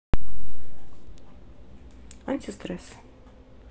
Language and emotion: Russian, neutral